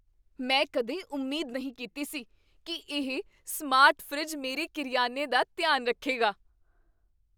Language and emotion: Punjabi, surprised